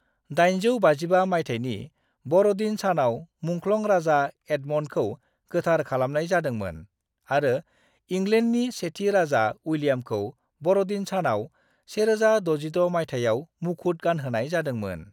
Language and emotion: Bodo, neutral